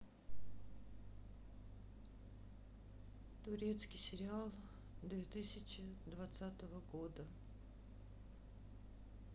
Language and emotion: Russian, sad